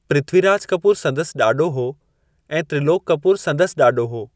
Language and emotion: Sindhi, neutral